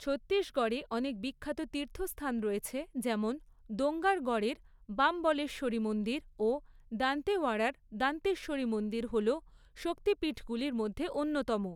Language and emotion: Bengali, neutral